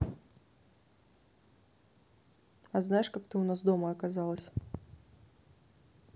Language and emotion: Russian, neutral